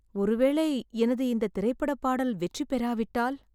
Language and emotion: Tamil, fearful